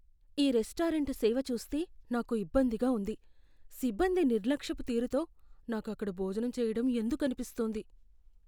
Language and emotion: Telugu, fearful